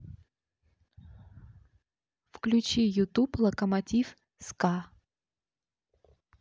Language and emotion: Russian, neutral